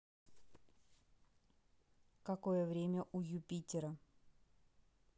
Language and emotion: Russian, neutral